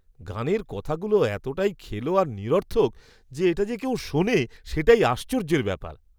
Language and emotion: Bengali, disgusted